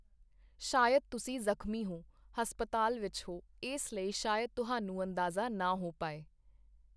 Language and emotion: Punjabi, neutral